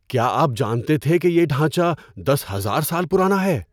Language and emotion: Urdu, surprised